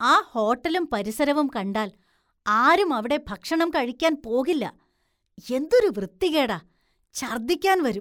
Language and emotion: Malayalam, disgusted